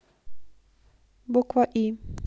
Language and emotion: Russian, neutral